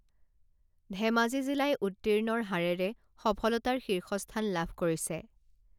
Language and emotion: Assamese, neutral